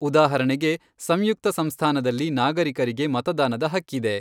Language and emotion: Kannada, neutral